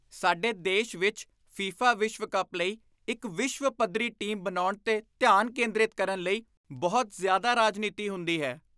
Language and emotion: Punjabi, disgusted